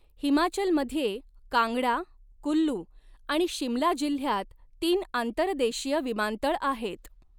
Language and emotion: Marathi, neutral